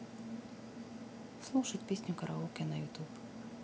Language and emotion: Russian, neutral